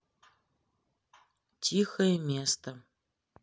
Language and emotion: Russian, neutral